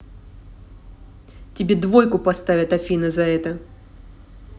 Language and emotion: Russian, angry